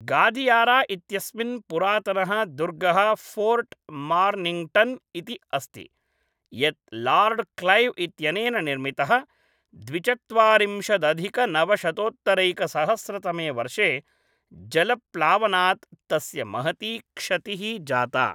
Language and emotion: Sanskrit, neutral